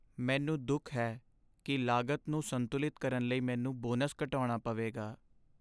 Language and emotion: Punjabi, sad